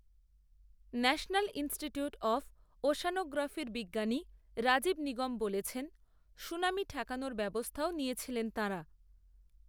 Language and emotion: Bengali, neutral